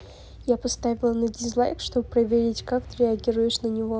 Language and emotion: Russian, neutral